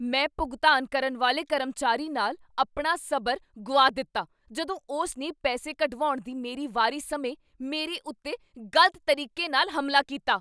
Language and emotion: Punjabi, angry